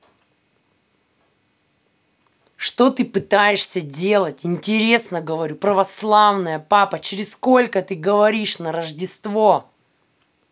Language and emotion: Russian, angry